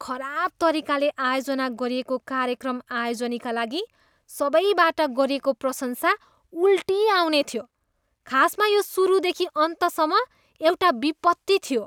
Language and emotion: Nepali, disgusted